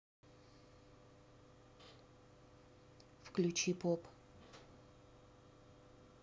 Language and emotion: Russian, neutral